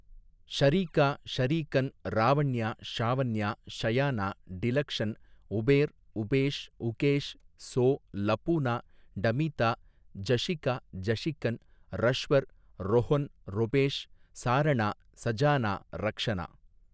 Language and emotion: Tamil, neutral